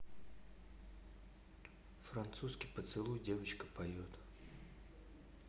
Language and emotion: Russian, neutral